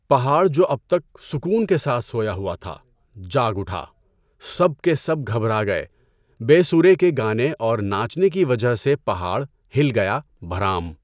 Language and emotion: Urdu, neutral